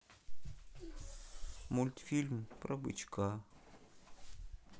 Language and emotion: Russian, sad